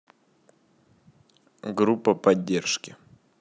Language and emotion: Russian, neutral